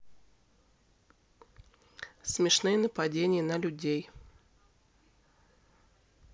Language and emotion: Russian, neutral